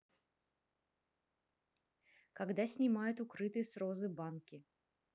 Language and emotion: Russian, neutral